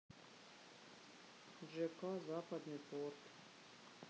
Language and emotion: Russian, sad